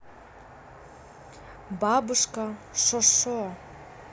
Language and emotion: Russian, neutral